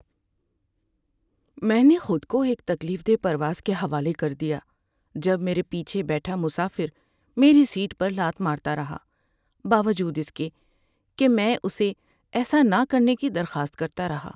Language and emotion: Urdu, sad